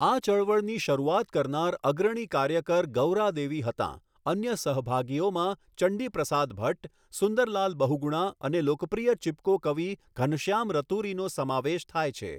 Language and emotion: Gujarati, neutral